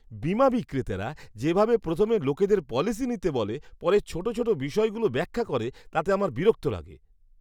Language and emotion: Bengali, disgusted